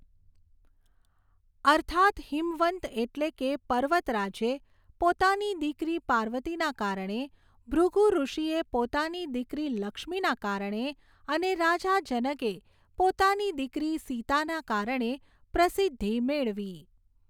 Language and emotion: Gujarati, neutral